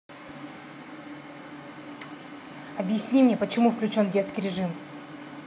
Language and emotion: Russian, angry